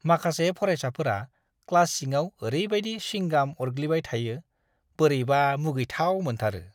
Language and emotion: Bodo, disgusted